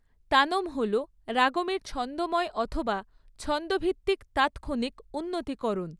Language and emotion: Bengali, neutral